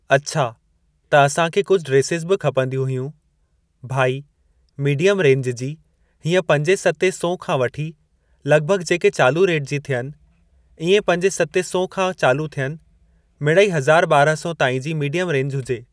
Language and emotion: Sindhi, neutral